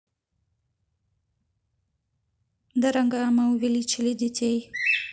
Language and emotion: Russian, neutral